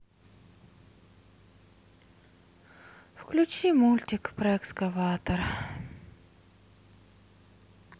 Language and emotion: Russian, sad